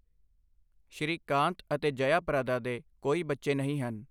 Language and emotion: Punjabi, neutral